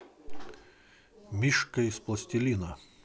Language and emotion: Russian, positive